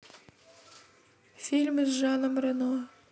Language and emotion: Russian, neutral